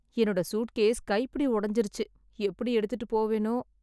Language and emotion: Tamil, sad